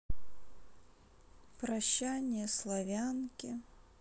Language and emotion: Russian, sad